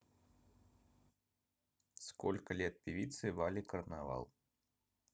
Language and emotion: Russian, neutral